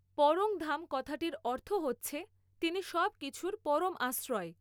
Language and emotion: Bengali, neutral